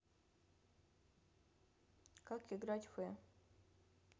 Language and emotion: Russian, neutral